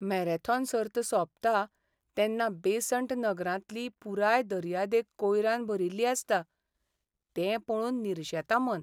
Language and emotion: Goan Konkani, sad